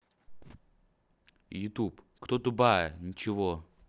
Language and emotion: Russian, neutral